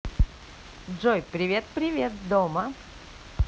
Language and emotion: Russian, positive